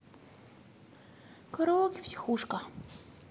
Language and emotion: Russian, neutral